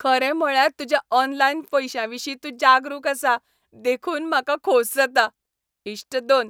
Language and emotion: Goan Konkani, happy